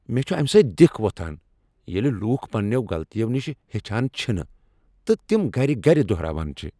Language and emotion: Kashmiri, angry